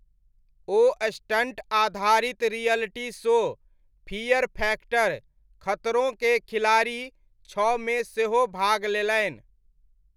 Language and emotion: Maithili, neutral